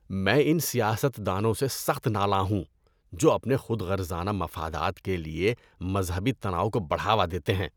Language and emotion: Urdu, disgusted